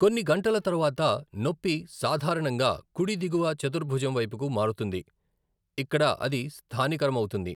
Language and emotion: Telugu, neutral